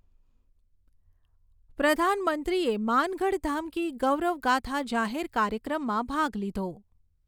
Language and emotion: Gujarati, neutral